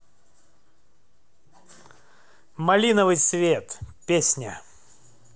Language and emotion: Russian, positive